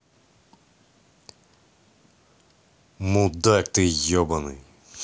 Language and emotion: Russian, angry